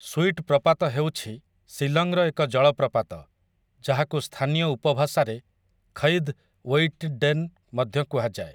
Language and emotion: Odia, neutral